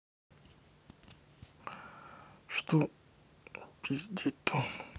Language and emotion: Russian, neutral